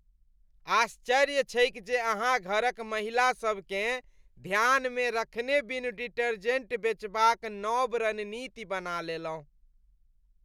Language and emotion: Maithili, disgusted